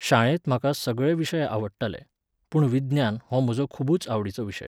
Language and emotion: Goan Konkani, neutral